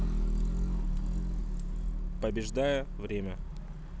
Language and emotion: Russian, neutral